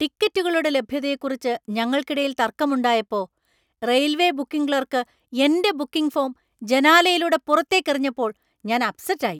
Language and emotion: Malayalam, angry